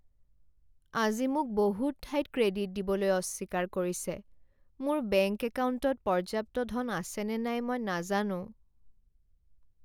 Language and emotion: Assamese, sad